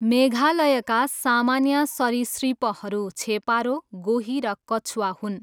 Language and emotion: Nepali, neutral